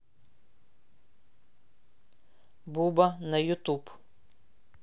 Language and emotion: Russian, neutral